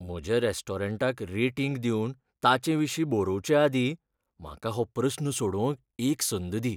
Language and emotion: Goan Konkani, fearful